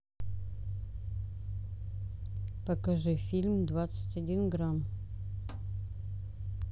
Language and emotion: Russian, neutral